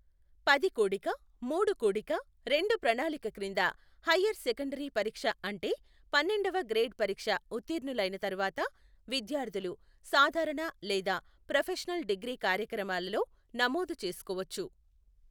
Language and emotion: Telugu, neutral